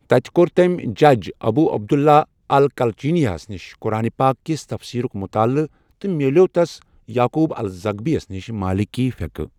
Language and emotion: Kashmiri, neutral